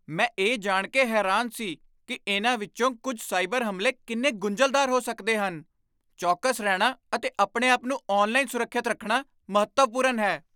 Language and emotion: Punjabi, surprised